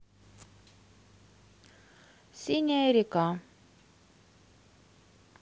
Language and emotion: Russian, neutral